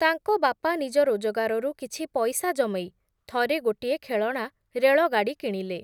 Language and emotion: Odia, neutral